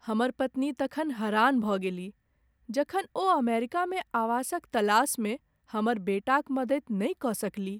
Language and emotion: Maithili, sad